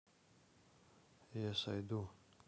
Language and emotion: Russian, neutral